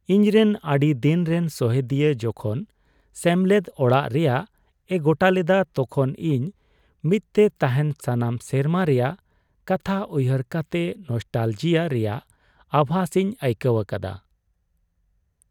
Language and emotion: Santali, sad